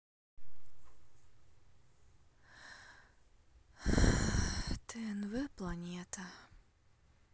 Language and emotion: Russian, sad